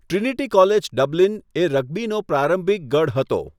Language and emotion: Gujarati, neutral